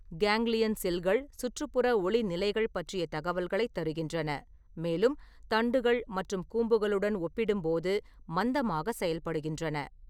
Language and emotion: Tamil, neutral